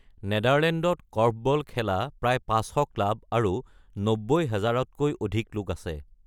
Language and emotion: Assamese, neutral